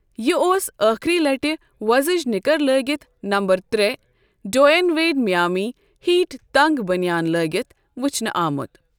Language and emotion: Kashmiri, neutral